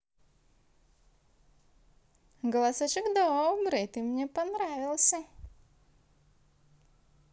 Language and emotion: Russian, positive